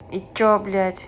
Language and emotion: Russian, angry